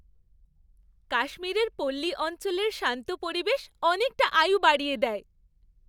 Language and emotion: Bengali, happy